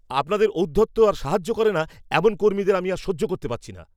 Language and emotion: Bengali, angry